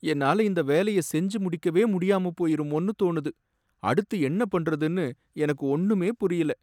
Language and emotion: Tamil, sad